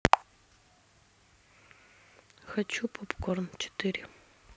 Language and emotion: Russian, neutral